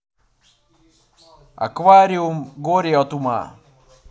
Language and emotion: Russian, neutral